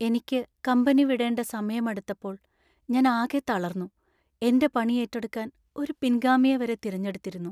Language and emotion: Malayalam, sad